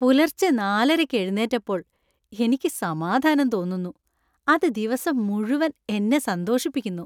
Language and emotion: Malayalam, happy